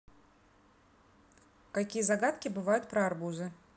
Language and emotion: Russian, neutral